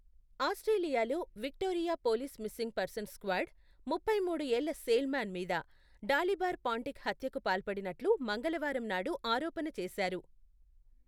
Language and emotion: Telugu, neutral